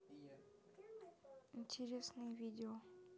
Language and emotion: Russian, neutral